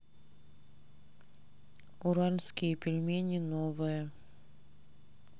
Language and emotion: Russian, neutral